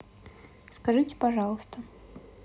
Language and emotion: Russian, neutral